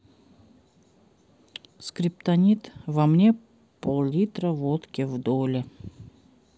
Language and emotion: Russian, sad